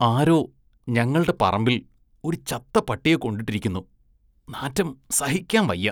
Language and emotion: Malayalam, disgusted